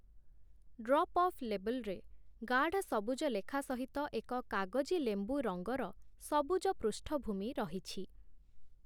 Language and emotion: Odia, neutral